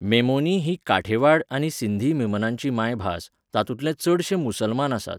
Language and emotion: Goan Konkani, neutral